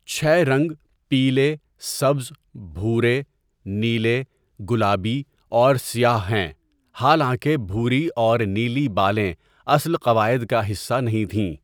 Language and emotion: Urdu, neutral